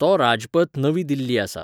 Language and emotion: Goan Konkani, neutral